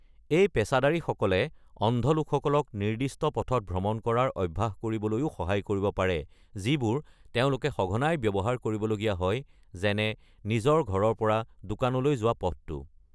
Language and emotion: Assamese, neutral